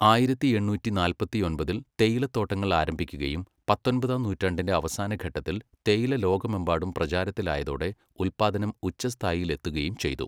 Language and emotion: Malayalam, neutral